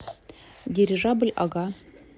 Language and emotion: Russian, neutral